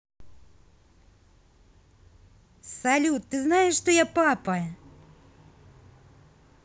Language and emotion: Russian, positive